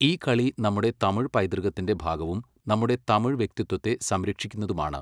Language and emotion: Malayalam, neutral